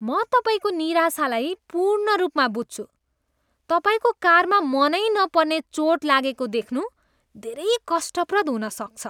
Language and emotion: Nepali, disgusted